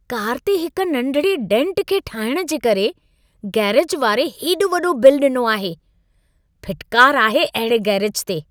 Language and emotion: Sindhi, disgusted